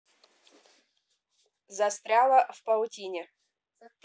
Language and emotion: Russian, neutral